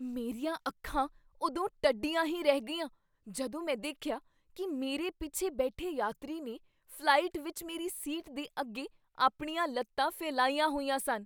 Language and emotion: Punjabi, surprised